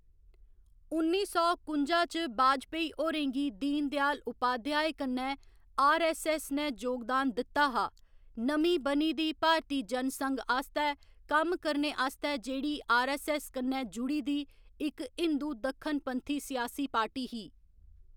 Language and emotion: Dogri, neutral